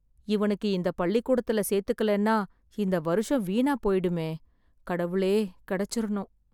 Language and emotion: Tamil, sad